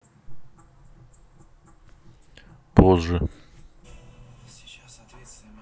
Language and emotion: Russian, neutral